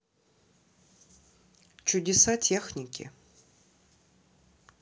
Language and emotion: Russian, neutral